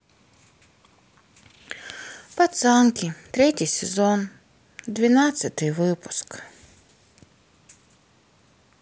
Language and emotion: Russian, sad